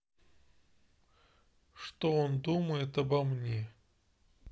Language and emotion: Russian, neutral